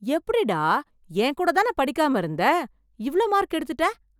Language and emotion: Tamil, surprised